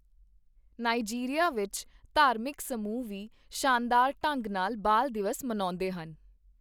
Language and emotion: Punjabi, neutral